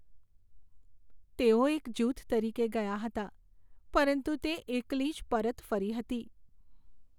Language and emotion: Gujarati, sad